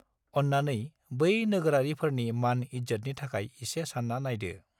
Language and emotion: Bodo, neutral